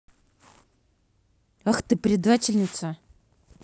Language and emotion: Russian, angry